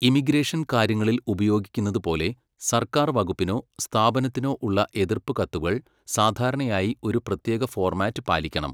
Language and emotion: Malayalam, neutral